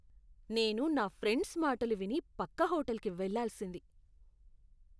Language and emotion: Telugu, disgusted